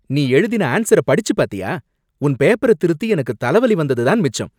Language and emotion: Tamil, angry